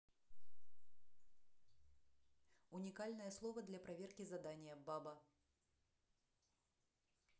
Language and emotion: Russian, neutral